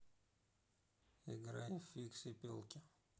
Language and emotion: Russian, neutral